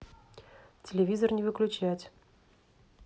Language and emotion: Russian, neutral